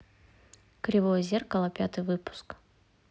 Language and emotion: Russian, neutral